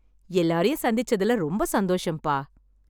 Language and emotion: Tamil, happy